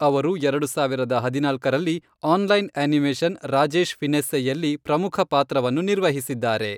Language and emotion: Kannada, neutral